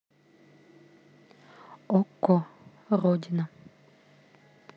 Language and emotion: Russian, neutral